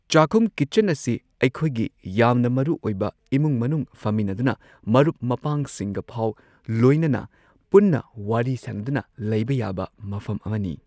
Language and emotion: Manipuri, neutral